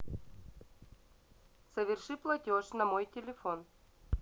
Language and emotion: Russian, neutral